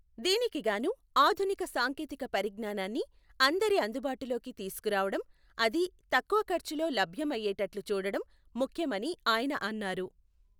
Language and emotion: Telugu, neutral